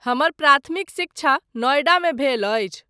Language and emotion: Maithili, neutral